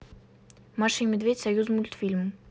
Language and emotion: Russian, neutral